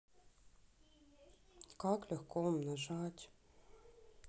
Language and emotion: Russian, sad